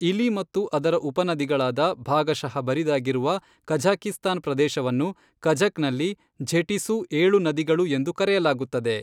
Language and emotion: Kannada, neutral